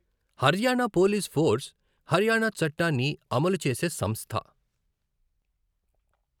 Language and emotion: Telugu, neutral